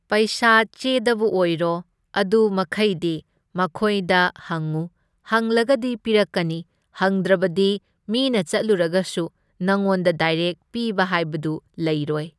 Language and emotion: Manipuri, neutral